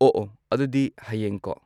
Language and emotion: Manipuri, neutral